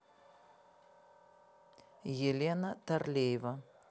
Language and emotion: Russian, neutral